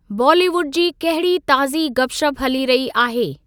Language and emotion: Sindhi, neutral